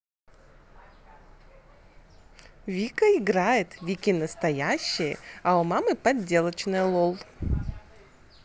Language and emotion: Russian, positive